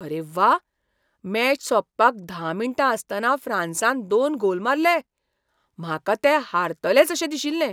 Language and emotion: Goan Konkani, surprised